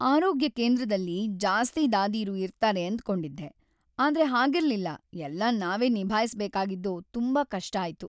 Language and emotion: Kannada, sad